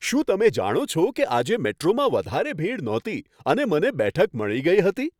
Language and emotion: Gujarati, happy